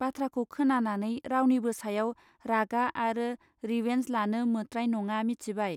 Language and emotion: Bodo, neutral